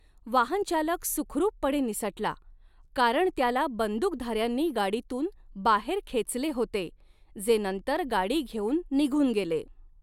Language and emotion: Marathi, neutral